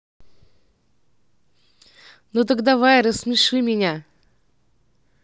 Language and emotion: Russian, neutral